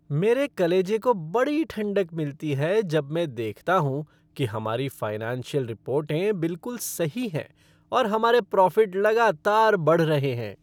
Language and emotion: Hindi, happy